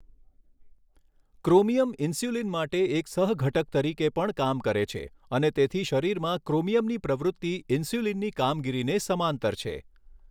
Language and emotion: Gujarati, neutral